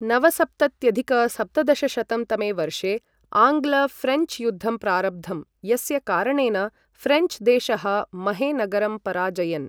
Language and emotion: Sanskrit, neutral